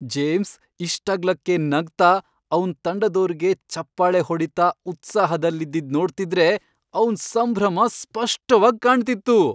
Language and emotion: Kannada, happy